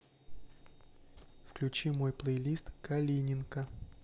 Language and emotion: Russian, neutral